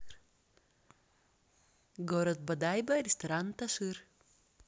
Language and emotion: Russian, neutral